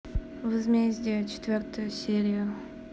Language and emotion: Russian, neutral